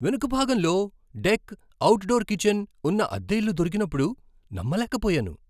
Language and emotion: Telugu, surprised